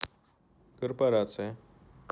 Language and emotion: Russian, neutral